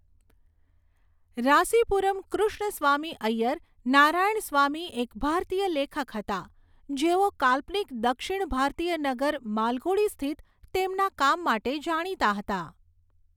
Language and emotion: Gujarati, neutral